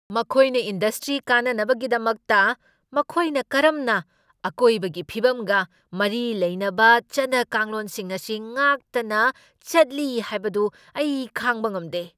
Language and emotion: Manipuri, angry